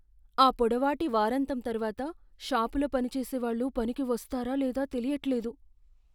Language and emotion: Telugu, fearful